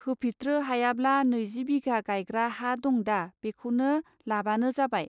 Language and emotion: Bodo, neutral